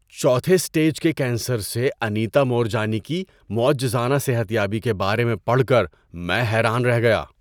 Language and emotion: Urdu, surprised